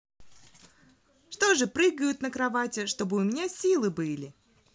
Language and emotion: Russian, positive